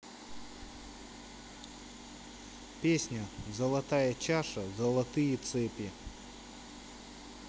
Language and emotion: Russian, neutral